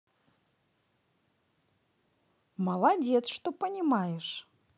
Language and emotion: Russian, positive